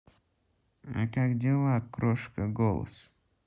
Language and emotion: Russian, neutral